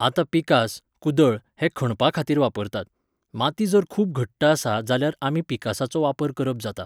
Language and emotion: Goan Konkani, neutral